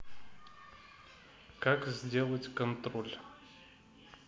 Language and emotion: Russian, neutral